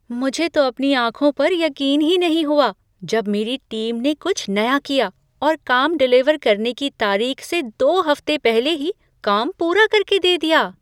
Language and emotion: Hindi, surprised